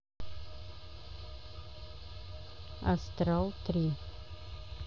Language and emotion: Russian, neutral